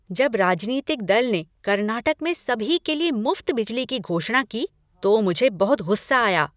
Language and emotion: Hindi, angry